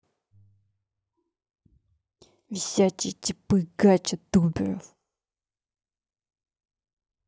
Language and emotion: Russian, angry